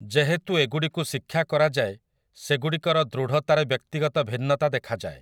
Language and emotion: Odia, neutral